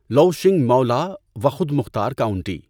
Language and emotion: Urdu, neutral